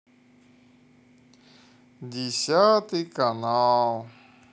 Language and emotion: Russian, sad